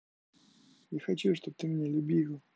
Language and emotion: Russian, sad